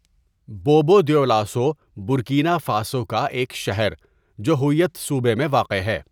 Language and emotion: Urdu, neutral